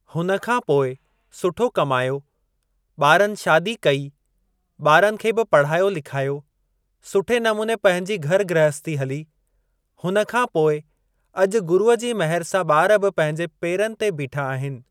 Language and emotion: Sindhi, neutral